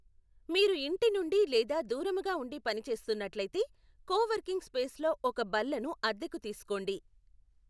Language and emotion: Telugu, neutral